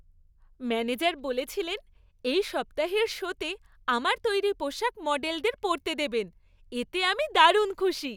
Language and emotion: Bengali, happy